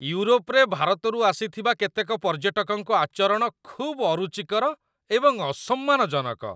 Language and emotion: Odia, disgusted